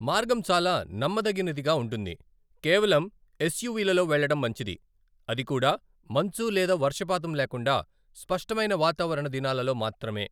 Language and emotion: Telugu, neutral